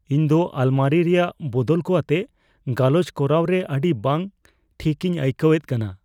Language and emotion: Santali, fearful